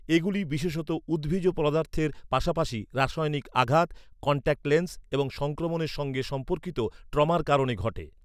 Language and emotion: Bengali, neutral